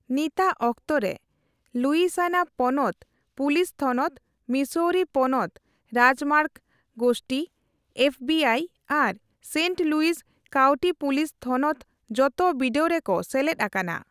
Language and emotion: Santali, neutral